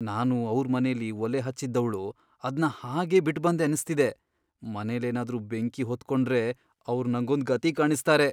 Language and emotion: Kannada, fearful